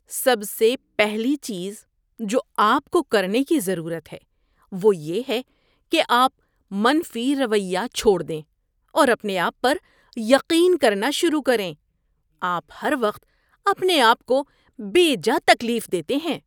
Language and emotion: Urdu, disgusted